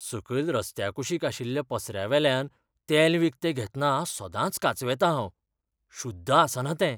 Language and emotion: Goan Konkani, fearful